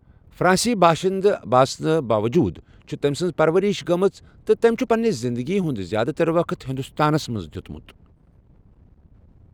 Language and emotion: Kashmiri, neutral